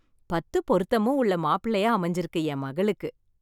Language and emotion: Tamil, happy